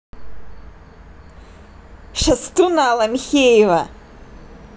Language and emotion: Russian, angry